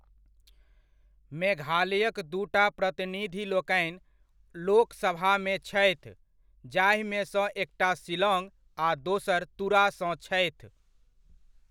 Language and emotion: Maithili, neutral